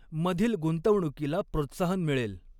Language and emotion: Marathi, neutral